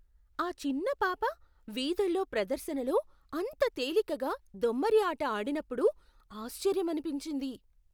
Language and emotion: Telugu, surprised